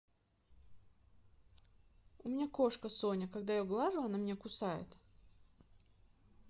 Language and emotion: Russian, neutral